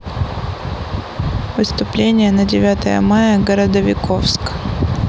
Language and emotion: Russian, neutral